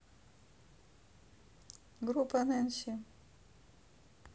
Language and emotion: Russian, neutral